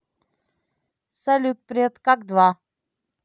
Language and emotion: Russian, neutral